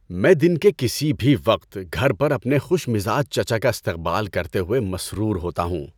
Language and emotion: Urdu, happy